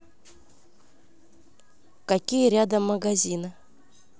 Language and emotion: Russian, neutral